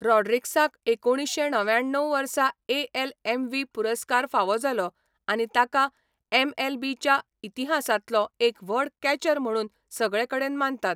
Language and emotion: Goan Konkani, neutral